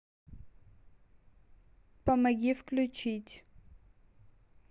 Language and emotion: Russian, neutral